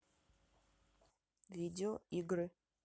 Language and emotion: Russian, neutral